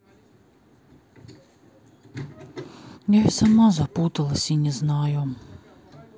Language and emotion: Russian, sad